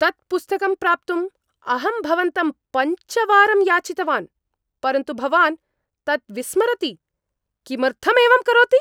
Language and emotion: Sanskrit, angry